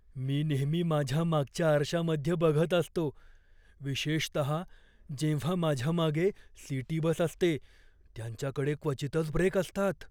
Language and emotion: Marathi, fearful